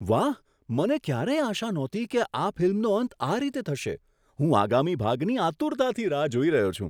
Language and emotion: Gujarati, surprised